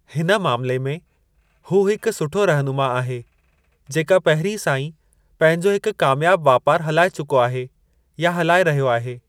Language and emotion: Sindhi, neutral